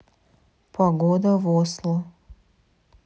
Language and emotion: Russian, neutral